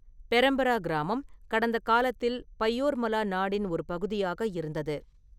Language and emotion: Tamil, neutral